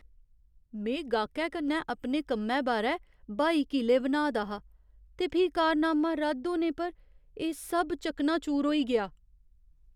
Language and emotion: Dogri, surprised